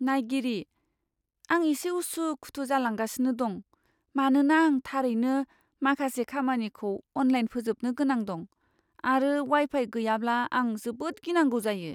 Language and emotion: Bodo, fearful